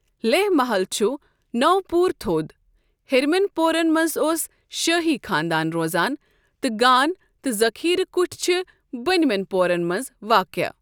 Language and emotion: Kashmiri, neutral